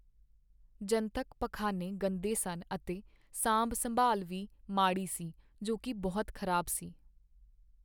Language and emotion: Punjabi, sad